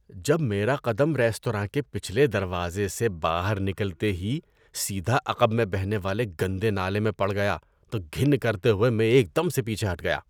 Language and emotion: Urdu, disgusted